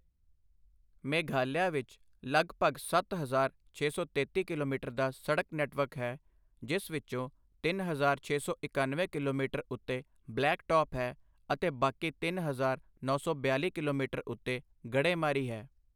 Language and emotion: Punjabi, neutral